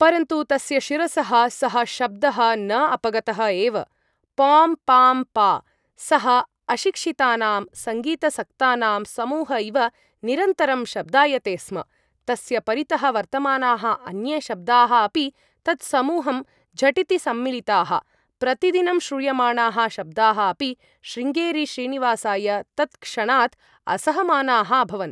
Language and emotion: Sanskrit, neutral